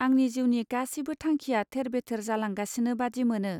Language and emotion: Bodo, neutral